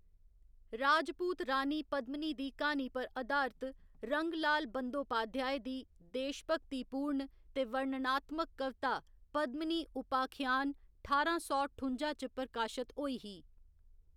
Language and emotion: Dogri, neutral